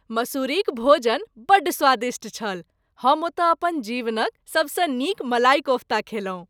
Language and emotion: Maithili, happy